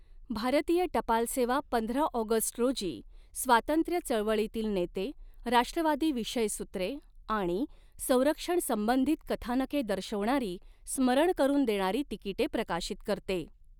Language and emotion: Marathi, neutral